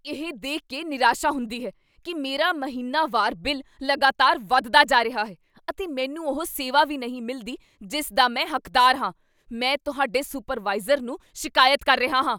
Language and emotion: Punjabi, angry